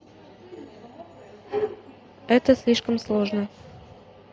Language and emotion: Russian, neutral